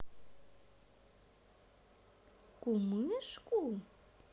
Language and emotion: Russian, neutral